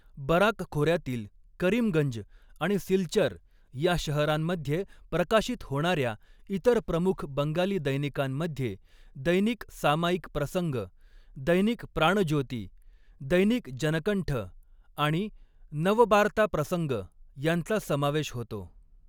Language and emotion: Marathi, neutral